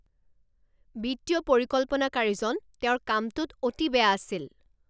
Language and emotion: Assamese, angry